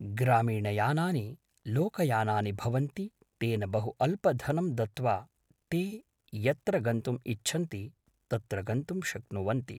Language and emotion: Sanskrit, neutral